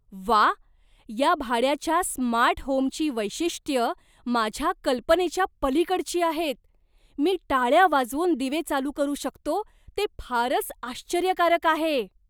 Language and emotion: Marathi, surprised